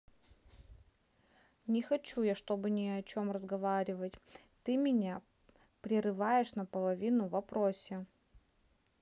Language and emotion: Russian, neutral